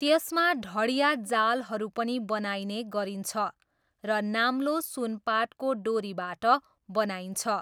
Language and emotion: Nepali, neutral